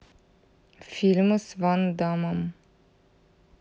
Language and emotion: Russian, neutral